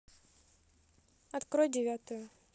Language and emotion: Russian, neutral